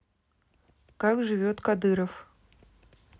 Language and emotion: Russian, neutral